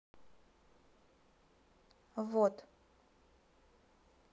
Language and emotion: Russian, neutral